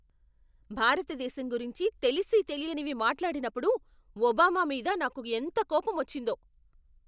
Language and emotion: Telugu, angry